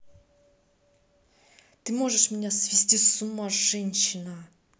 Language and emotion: Russian, neutral